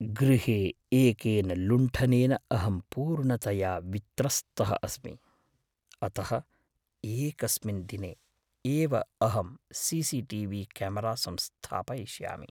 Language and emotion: Sanskrit, fearful